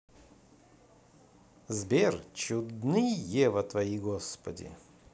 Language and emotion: Russian, positive